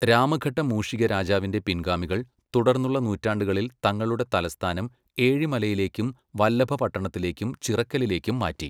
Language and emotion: Malayalam, neutral